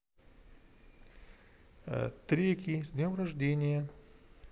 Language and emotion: Russian, neutral